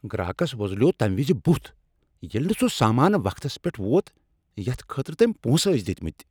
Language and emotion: Kashmiri, angry